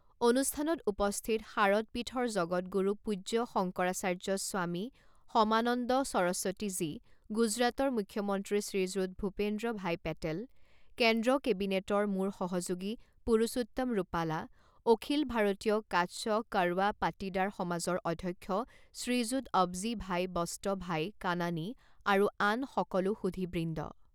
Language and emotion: Assamese, neutral